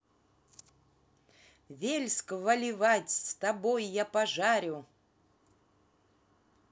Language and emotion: Russian, positive